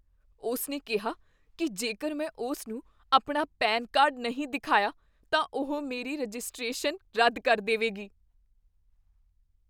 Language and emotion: Punjabi, fearful